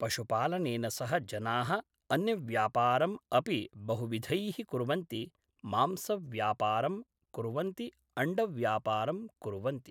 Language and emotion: Sanskrit, neutral